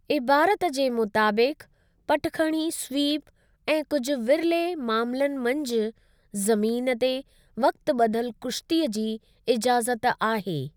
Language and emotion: Sindhi, neutral